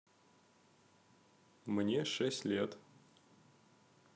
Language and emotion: Russian, neutral